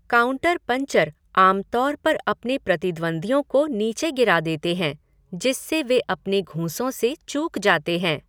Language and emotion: Hindi, neutral